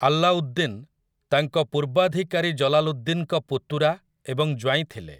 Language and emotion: Odia, neutral